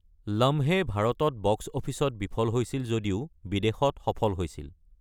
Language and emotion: Assamese, neutral